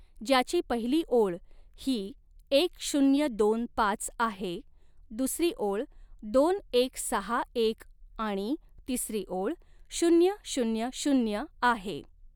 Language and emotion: Marathi, neutral